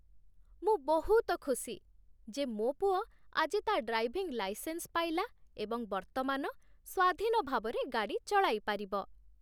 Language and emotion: Odia, happy